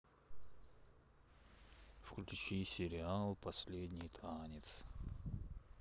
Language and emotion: Russian, neutral